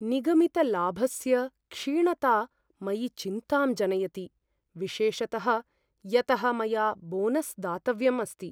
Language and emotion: Sanskrit, fearful